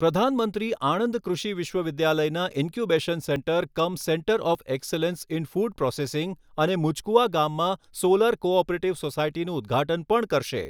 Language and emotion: Gujarati, neutral